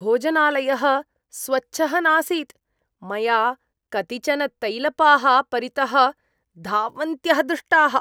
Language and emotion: Sanskrit, disgusted